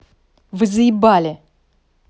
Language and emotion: Russian, angry